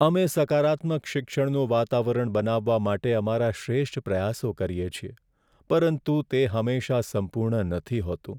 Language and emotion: Gujarati, sad